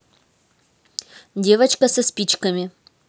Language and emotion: Russian, neutral